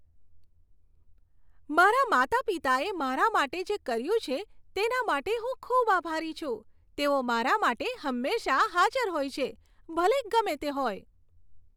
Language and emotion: Gujarati, happy